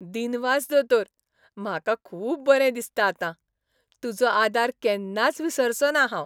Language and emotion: Goan Konkani, happy